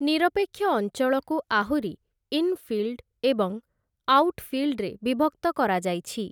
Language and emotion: Odia, neutral